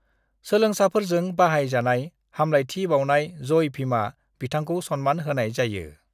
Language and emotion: Bodo, neutral